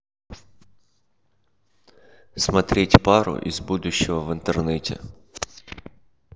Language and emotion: Russian, neutral